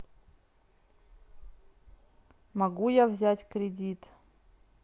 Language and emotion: Russian, neutral